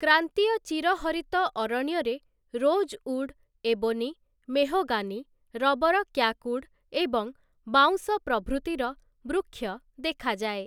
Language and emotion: Odia, neutral